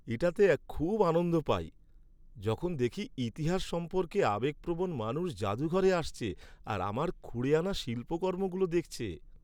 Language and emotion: Bengali, happy